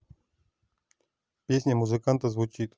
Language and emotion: Russian, neutral